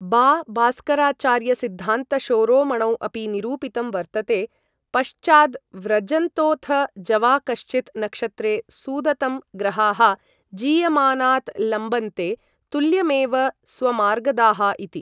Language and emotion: Sanskrit, neutral